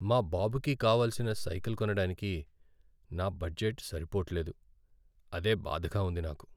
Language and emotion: Telugu, sad